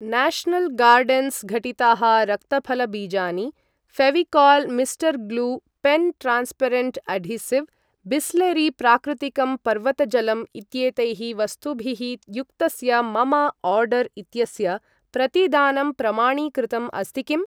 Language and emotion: Sanskrit, neutral